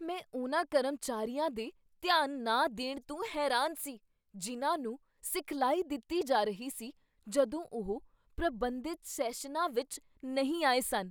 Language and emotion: Punjabi, surprised